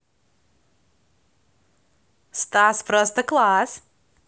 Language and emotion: Russian, positive